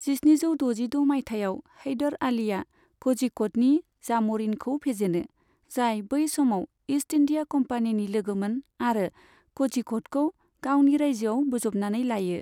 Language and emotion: Bodo, neutral